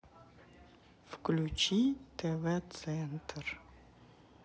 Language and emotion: Russian, neutral